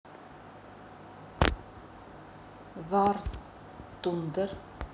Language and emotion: Russian, neutral